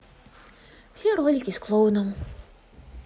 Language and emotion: Russian, sad